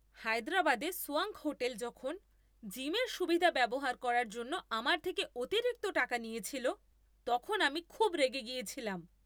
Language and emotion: Bengali, angry